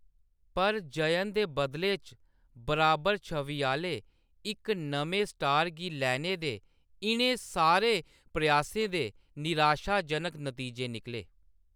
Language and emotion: Dogri, neutral